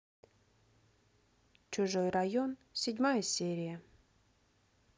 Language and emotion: Russian, neutral